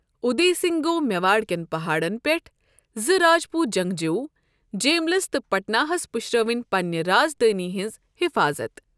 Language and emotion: Kashmiri, neutral